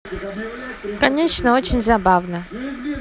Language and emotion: Russian, neutral